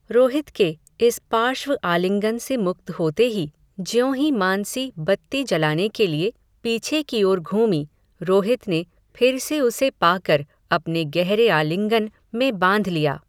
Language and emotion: Hindi, neutral